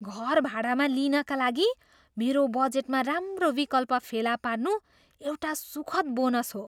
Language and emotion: Nepali, surprised